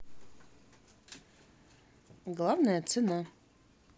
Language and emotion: Russian, neutral